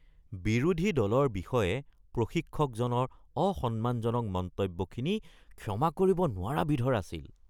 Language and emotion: Assamese, disgusted